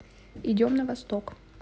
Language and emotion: Russian, neutral